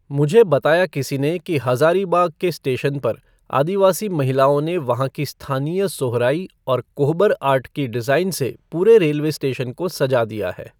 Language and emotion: Hindi, neutral